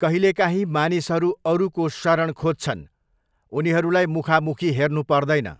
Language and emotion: Nepali, neutral